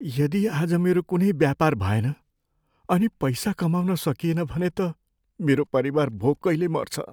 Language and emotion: Nepali, fearful